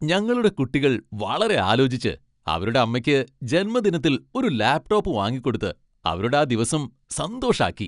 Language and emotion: Malayalam, happy